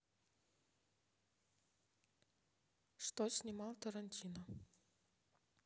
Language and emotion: Russian, neutral